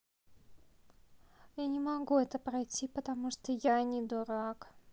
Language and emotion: Russian, sad